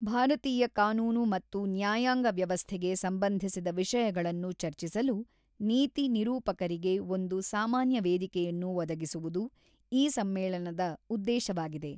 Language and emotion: Kannada, neutral